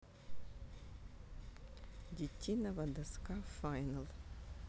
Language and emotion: Russian, neutral